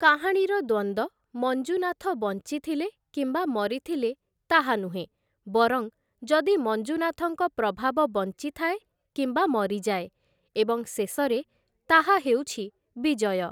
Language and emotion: Odia, neutral